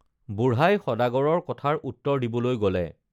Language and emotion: Assamese, neutral